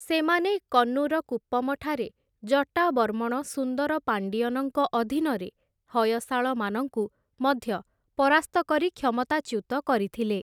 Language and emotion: Odia, neutral